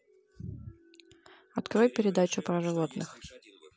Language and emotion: Russian, neutral